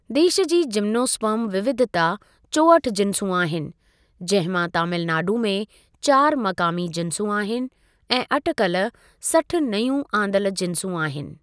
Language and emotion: Sindhi, neutral